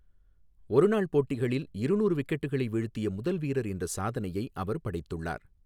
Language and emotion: Tamil, neutral